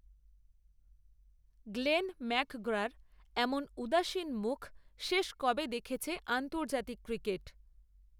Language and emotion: Bengali, neutral